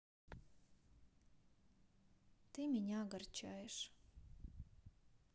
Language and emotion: Russian, sad